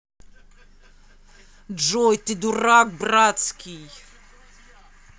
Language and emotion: Russian, angry